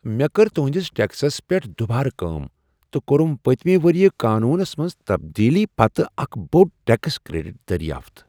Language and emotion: Kashmiri, surprised